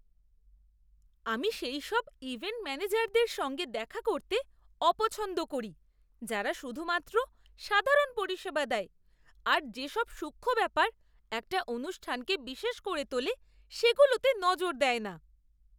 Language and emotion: Bengali, disgusted